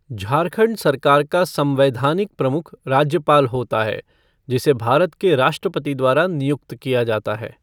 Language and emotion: Hindi, neutral